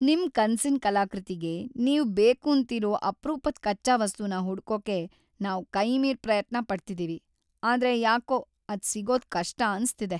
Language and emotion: Kannada, sad